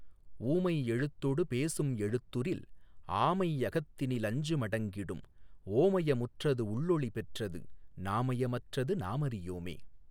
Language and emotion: Tamil, neutral